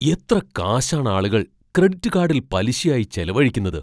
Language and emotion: Malayalam, surprised